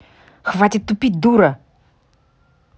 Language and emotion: Russian, angry